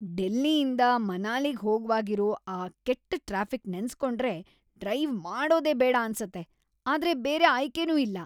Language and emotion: Kannada, disgusted